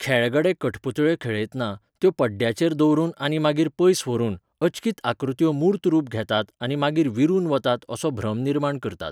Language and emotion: Goan Konkani, neutral